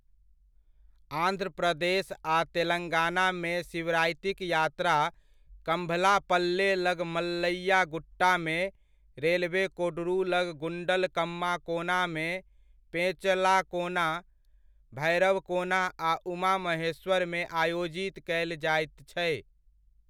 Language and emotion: Maithili, neutral